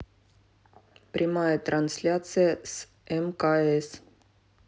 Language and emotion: Russian, neutral